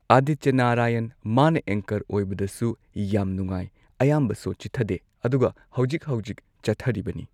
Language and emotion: Manipuri, neutral